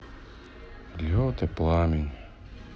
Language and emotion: Russian, sad